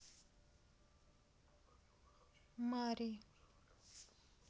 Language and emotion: Russian, neutral